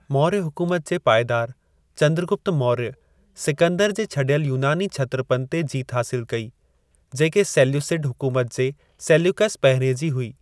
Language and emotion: Sindhi, neutral